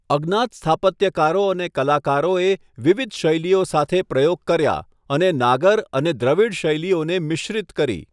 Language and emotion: Gujarati, neutral